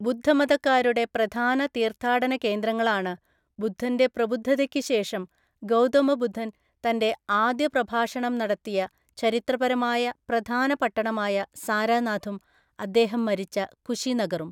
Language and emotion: Malayalam, neutral